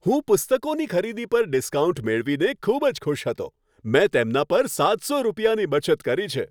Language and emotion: Gujarati, happy